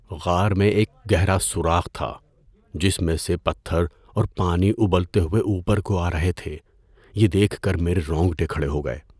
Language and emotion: Urdu, fearful